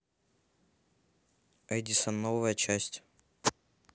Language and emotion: Russian, neutral